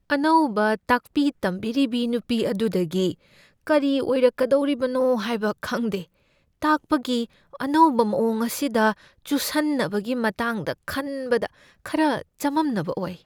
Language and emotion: Manipuri, fearful